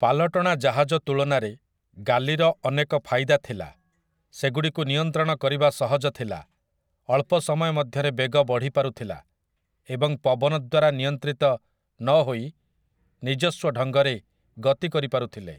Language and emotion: Odia, neutral